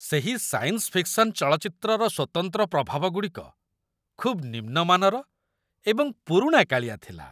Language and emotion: Odia, disgusted